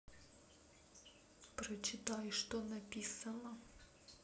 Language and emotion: Russian, neutral